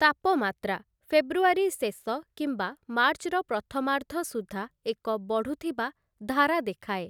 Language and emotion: Odia, neutral